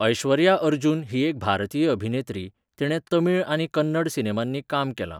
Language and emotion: Goan Konkani, neutral